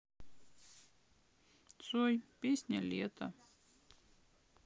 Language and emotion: Russian, sad